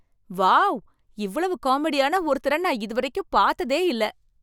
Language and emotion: Tamil, surprised